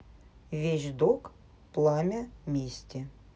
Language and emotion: Russian, neutral